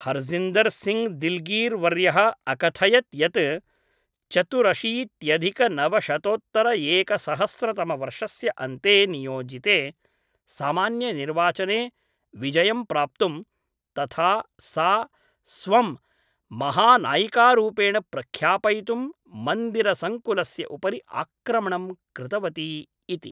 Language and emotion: Sanskrit, neutral